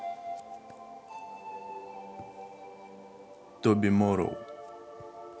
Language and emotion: Russian, neutral